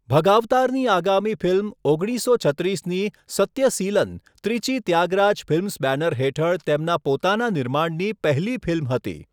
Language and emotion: Gujarati, neutral